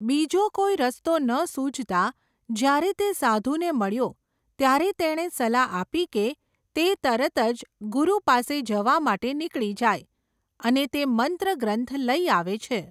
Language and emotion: Gujarati, neutral